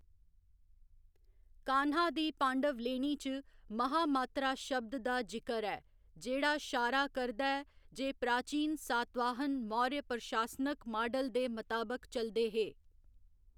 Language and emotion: Dogri, neutral